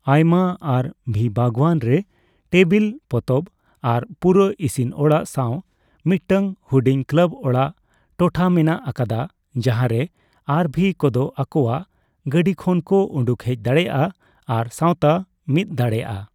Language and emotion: Santali, neutral